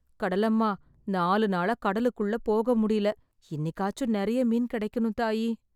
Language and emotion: Tamil, sad